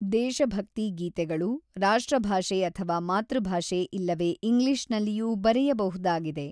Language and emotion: Kannada, neutral